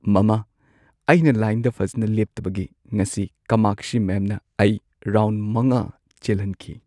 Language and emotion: Manipuri, sad